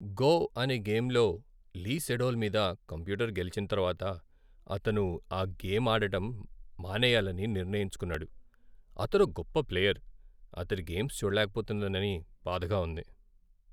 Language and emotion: Telugu, sad